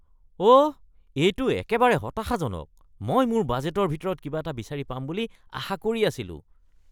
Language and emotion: Assamese, disgusted